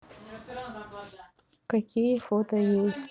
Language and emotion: Russian, neutral